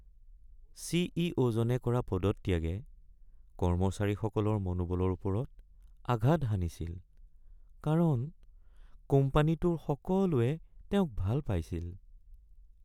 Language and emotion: Assamese, sad